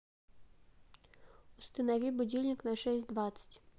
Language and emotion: Russian, neutral